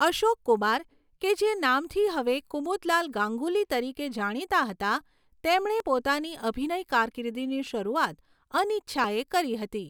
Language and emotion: Gujarati, neutral